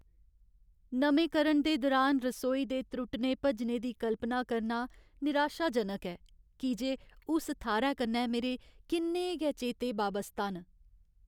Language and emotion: Dogri, sad